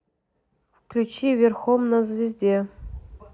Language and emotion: Russian, neutral